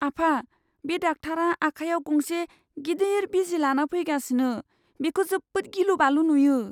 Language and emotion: Bodo, fearful